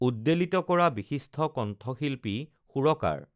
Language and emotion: Assamese, neutral